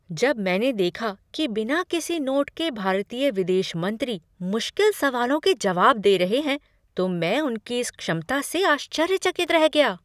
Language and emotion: Hindi, surprised